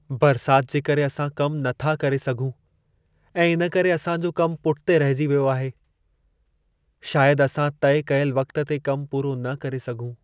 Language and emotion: Sindhi, sad